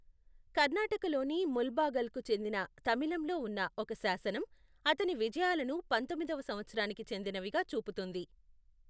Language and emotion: Telugu, neutral